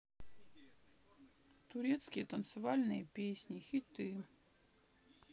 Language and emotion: Russian, sad